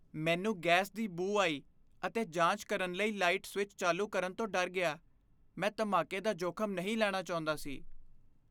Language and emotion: Punjabi, fearful